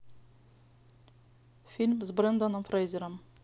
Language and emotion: Russian, neutral